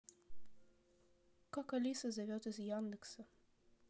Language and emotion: Russian, neutral